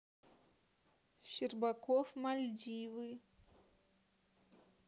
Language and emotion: Russian, neutral